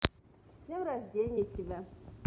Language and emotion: Russian, positive